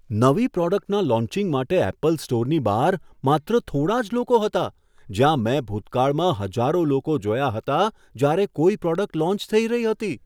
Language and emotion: Gujarati, surprised